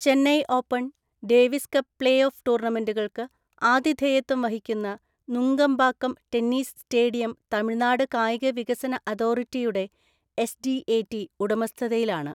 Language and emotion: Malayalam, neutral